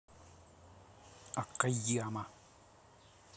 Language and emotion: Russian, angry